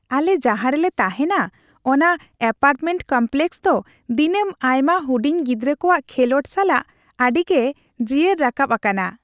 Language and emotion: Santali, happy